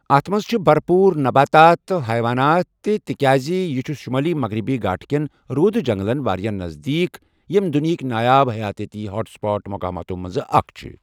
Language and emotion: Kashmiri, neutral